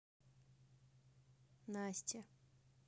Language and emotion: Russian, neutral